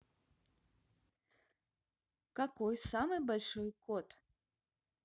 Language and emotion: Russian, neutral